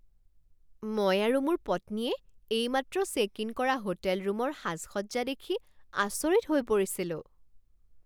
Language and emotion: Assamese, surprised